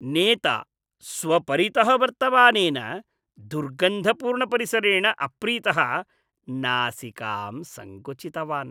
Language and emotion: Sanskrit, disgusted